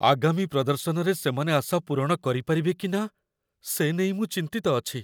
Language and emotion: Odia, fearful